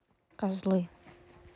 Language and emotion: Russian, neutral